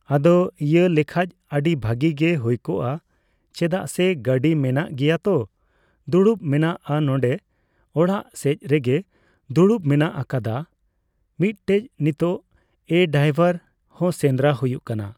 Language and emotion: Santali, neutral